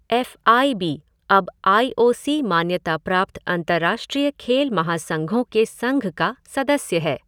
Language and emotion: Hindi, neutral